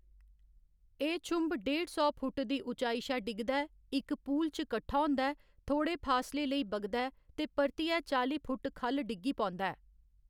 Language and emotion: Dogri, neutral